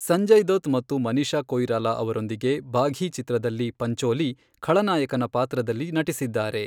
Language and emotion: Kannada, neutral